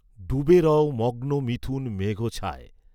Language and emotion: Bengali, neutral